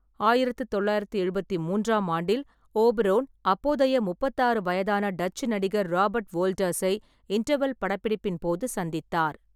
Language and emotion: Tamil, neutral